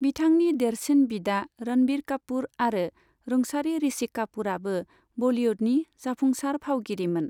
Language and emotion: Bodo, neutral